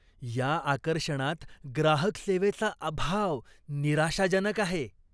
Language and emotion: Marathi, disgusted